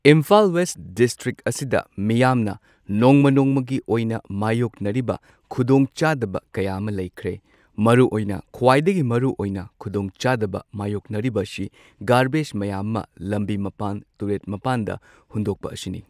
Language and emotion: Manipuri, neutral